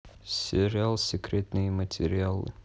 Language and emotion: Russian, neutral